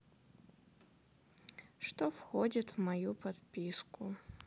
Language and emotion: Russian, sad